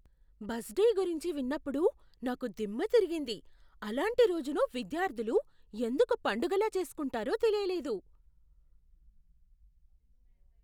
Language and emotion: Telugu, surprised